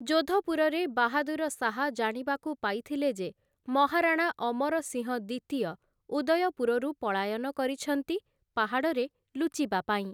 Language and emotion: Odia, neutral